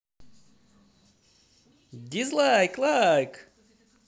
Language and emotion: Russian, positive